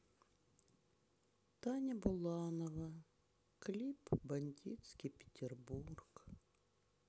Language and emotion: Russian, sad